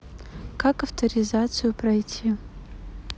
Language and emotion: Russian, neutral